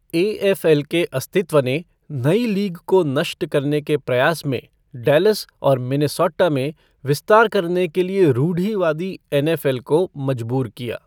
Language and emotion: Hindi, neutral